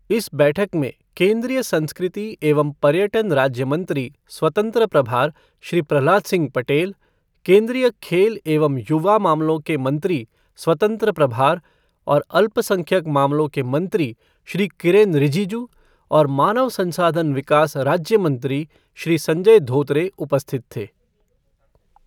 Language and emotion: Hindi, neutral